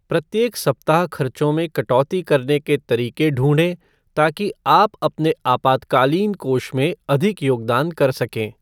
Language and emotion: Hindi, neutral